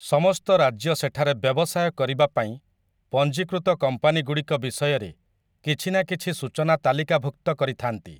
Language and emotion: Odia, neutral